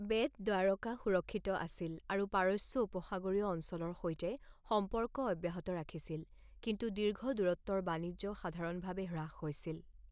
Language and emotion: Assamese, neutral